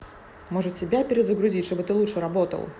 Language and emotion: Russian, angry